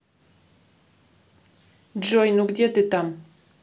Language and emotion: Russian, neutral